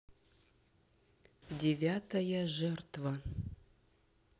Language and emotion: Russian, neutral